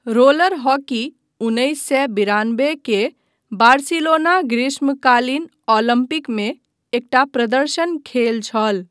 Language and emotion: Maithili, neutral